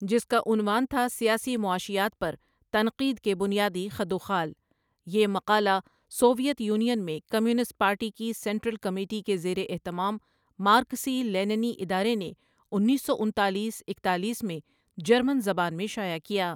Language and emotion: Urdu, neutral